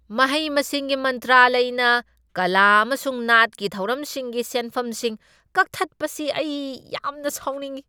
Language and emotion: Manipuri, angry